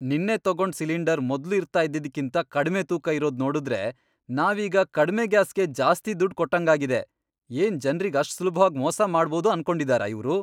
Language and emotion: Kannada, angry